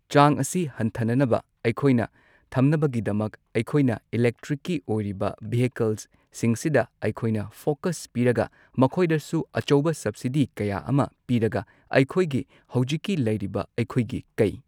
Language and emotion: Manipuri, neutral